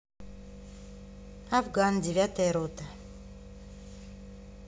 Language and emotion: Russian, neutral